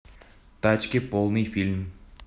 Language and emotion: Russian, neutral